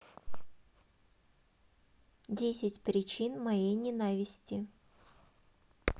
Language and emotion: Russian, neutral